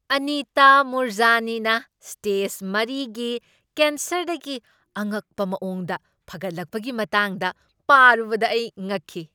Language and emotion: Manipuri, surprised